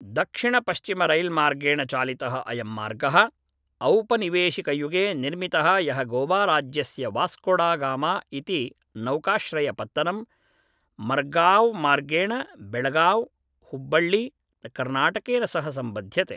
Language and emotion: Sanskrit, neutral